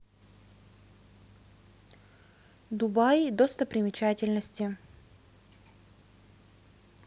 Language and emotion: Russian, neutral